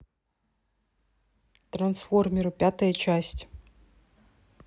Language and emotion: Russian, neutral